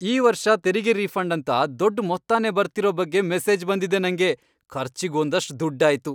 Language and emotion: Kannada, happy